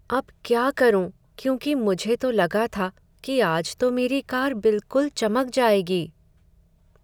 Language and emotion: Hindi, sad